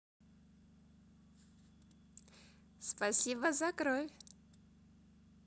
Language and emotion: Russian, positive